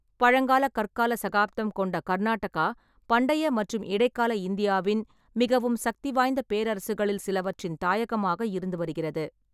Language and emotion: Tamil, neutral